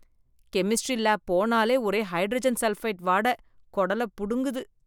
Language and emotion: Tamil, disgusted